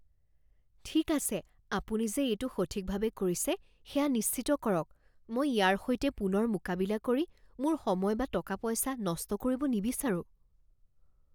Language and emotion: Assamese, fearful